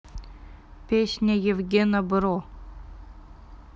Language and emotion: Russian, neutral